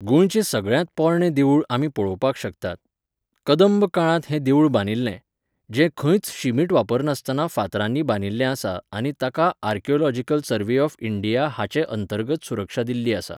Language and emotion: Goan Konkani, neutral